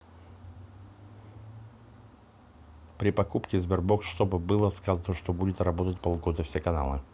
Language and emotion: Russian, neutral